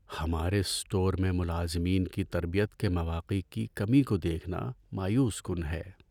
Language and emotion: Urdu, sad